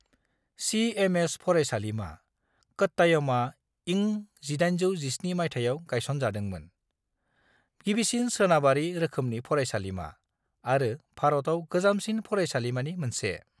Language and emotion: Bodo, neutral